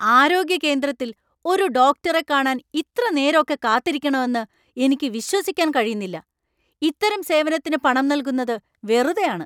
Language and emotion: Malayalam, angry